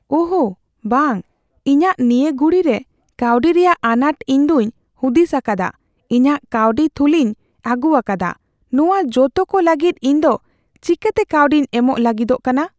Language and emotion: Santali, fearful